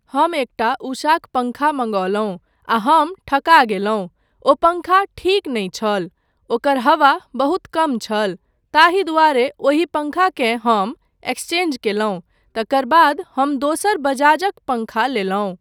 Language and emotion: Maithili, neutral